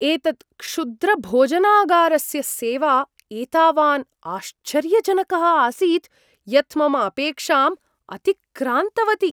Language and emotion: Sanskrit, surprised